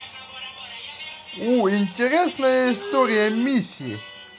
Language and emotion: Russian, positive